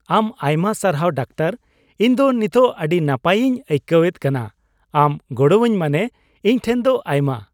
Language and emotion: Santali, happy